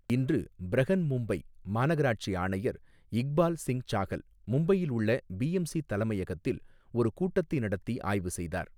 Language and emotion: Tamil, neutral